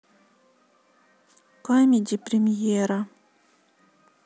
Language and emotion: Russian, sad